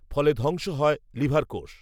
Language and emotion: Bengali, neutral